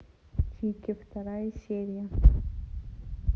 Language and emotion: Russian, neutral